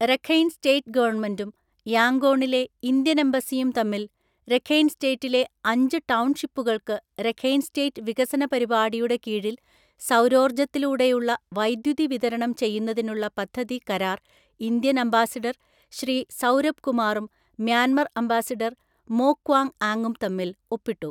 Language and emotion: Malayalam, neutral